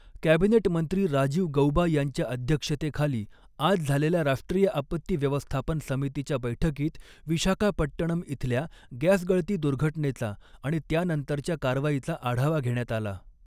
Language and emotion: Marathi, neutral